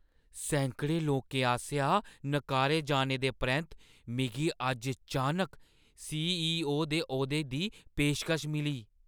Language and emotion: Dogri, surprised